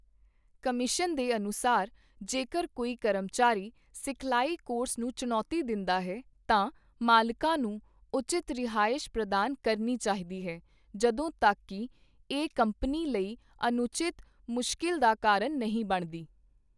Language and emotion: Punjabi, neutral